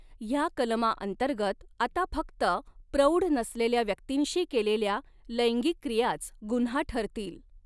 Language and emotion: Marathi, neutral